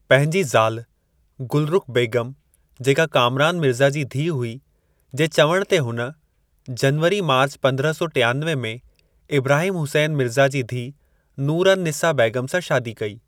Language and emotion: Sindhi, neutral